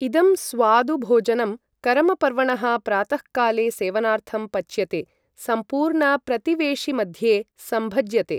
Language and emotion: Sanskrit, neutral